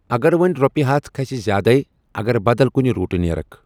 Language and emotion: Kashmiri, neutral